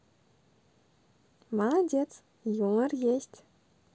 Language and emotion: Russian, positive